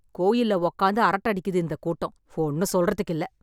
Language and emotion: Tamil, angry